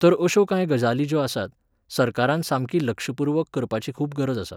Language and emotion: Goan Konkani, neutral